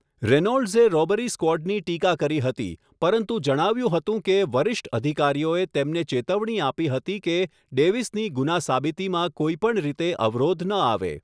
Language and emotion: Gujarati, neutral